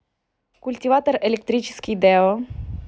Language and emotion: Russian, neutral